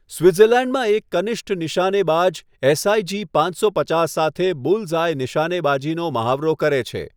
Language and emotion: Gujarati, neutral